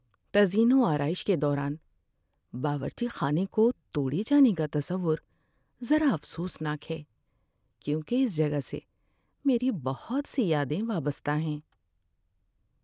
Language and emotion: Urdu, sad